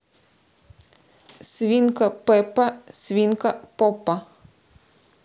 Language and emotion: Russian, neutral